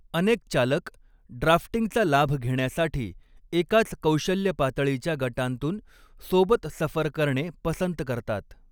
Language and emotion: Marathi, neutral